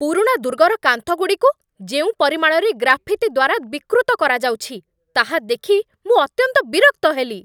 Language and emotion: Odia, angry